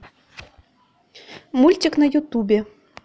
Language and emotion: Russian, neutral